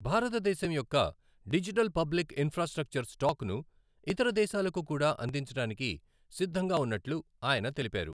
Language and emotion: Telugu, neutral